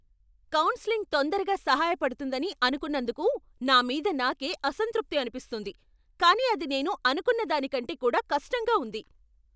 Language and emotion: Telugu, angry